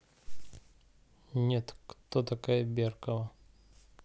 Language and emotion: Russian, neutral